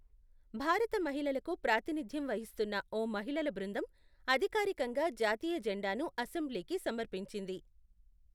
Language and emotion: Telugu, neutral